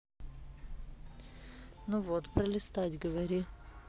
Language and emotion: Russian, neutral